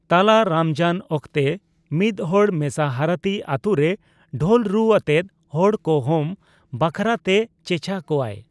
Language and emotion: Santali, neutral